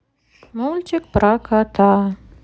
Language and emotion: Russian, sad